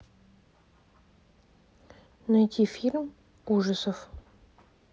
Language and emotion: Russian, neutral